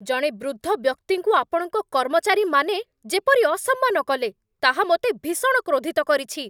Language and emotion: Odia, angry